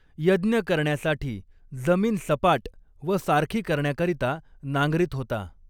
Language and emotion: Marathi, neutral